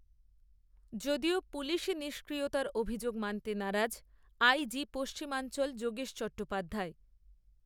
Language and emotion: Bengali, neutral